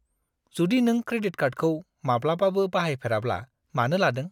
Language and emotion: Bodo, disgusted